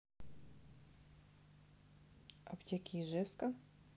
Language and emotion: Russian, neutral